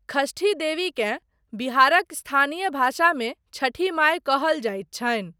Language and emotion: Maithili, neutral